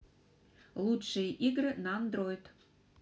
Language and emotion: Russian, neutral